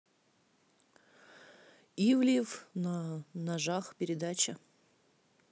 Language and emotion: Russian, neutral